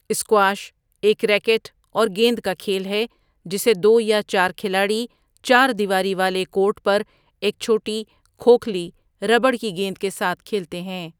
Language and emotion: Urdu, neutral